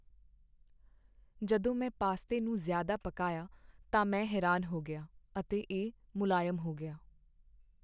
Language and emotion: Punjabi, sad